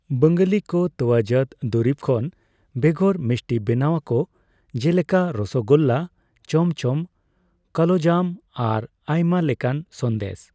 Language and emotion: Santali, neutral